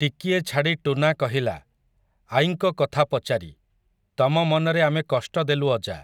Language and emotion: Odia, neutral